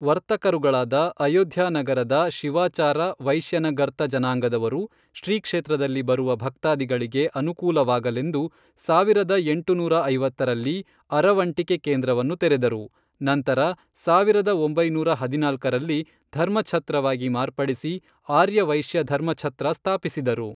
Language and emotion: Kannada, neutral